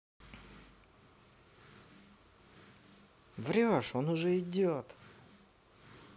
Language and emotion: Russian, positive